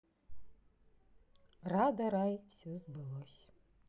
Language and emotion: Russian, neutral